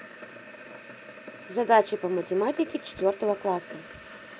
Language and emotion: Russian, neutral